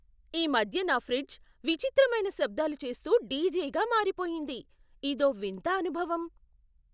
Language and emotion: Telugu, surprised